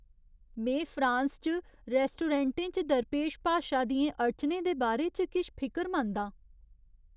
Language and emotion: Dogri, fearful